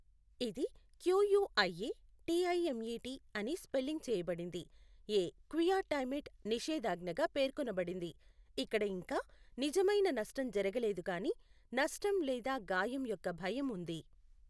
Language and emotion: Telugu, neutral